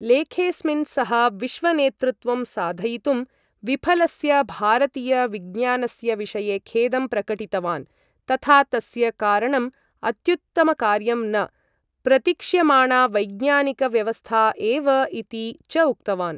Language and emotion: Sanskrit, neutral